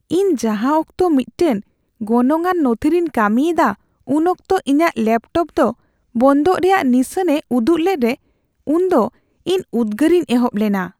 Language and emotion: Santali, fearful